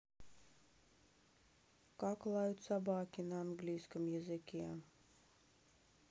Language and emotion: Russian, sad